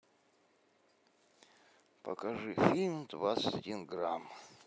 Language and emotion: Russian, neutral